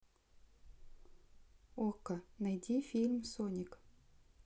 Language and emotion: Russian, neutral